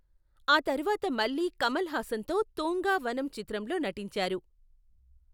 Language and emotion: Telugu, neutral